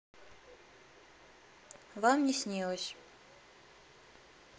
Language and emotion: Russian, neutral